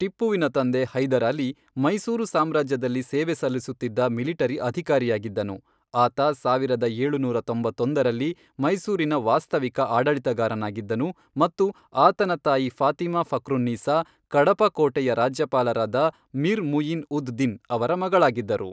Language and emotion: Kannada, neutral